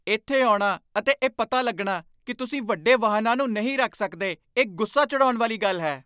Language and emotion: Punjabi, angry